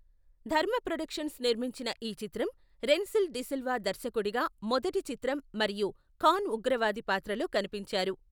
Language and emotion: Telugu, neutral